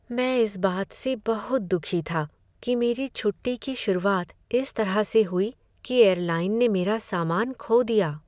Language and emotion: Hindi, sad